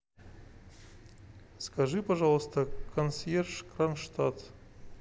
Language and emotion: Russian, neutral